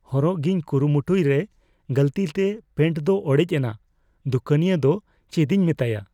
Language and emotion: Santali, fearful